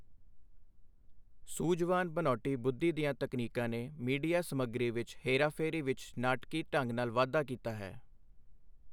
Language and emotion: Punjabi, neutral